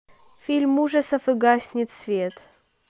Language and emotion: Russian, neutral